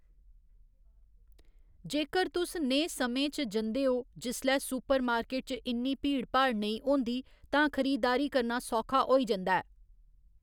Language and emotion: Dogri, neutral